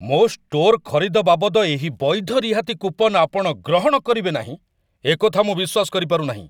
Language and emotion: Odia, angry